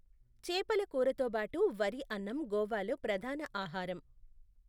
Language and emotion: Telugu, neutral